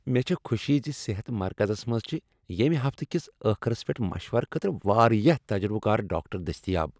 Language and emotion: Kashmiri, happy